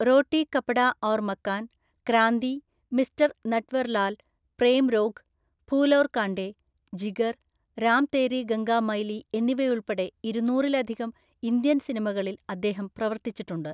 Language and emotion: Malayalam, neutral